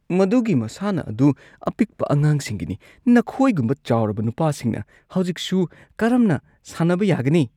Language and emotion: Manipuri, disgusted